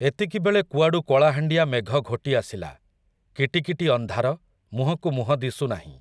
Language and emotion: Odia, neutral